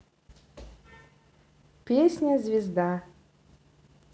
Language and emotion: Russian, neutral